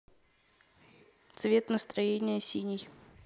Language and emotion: Russian, neutral